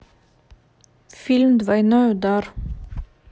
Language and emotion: Russian, neutral